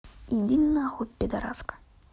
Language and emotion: Russian, angry